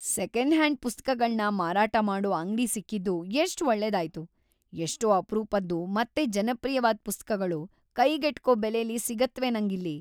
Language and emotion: Kannada, happy